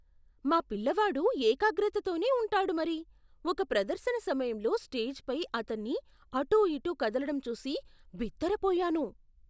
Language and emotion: Telugu, surprised